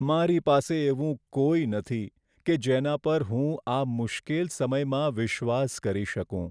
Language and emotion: Gujarati, sad